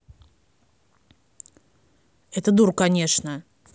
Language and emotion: Russian, angry